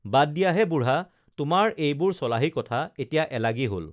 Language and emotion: Assamese, neutral